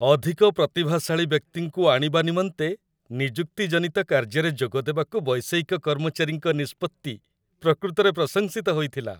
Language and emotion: Odia, happy